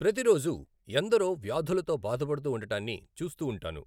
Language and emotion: Telugu, neutral